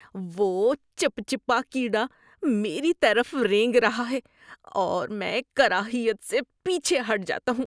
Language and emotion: Urdu, disgusted